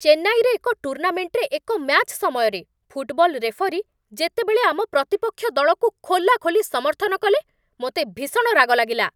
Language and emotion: Odia, angry